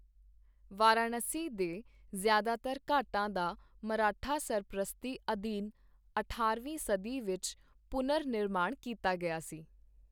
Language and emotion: Punjabi, neutral